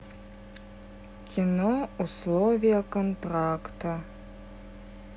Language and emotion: Russian, sad